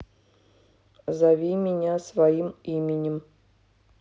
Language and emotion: Russian, neutral